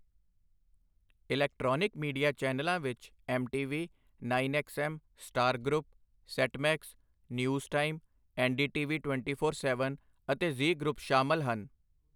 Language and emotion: Punjabi, neutral